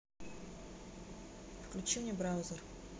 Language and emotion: Russian, neutral